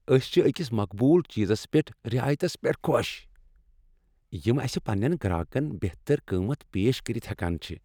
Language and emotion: Kashmiri, happy